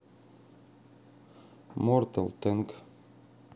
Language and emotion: Russian, neutral